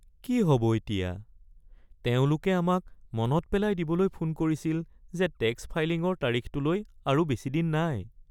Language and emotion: Assamese, sad